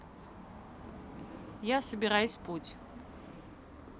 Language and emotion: Russian, neutral